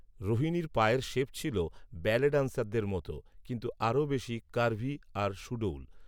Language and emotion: Bengali, neutral